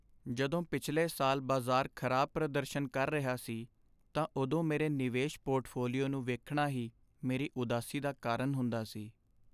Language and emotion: Punjabi, sad